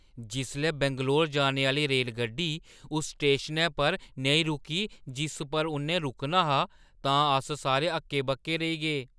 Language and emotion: Dogri, surprised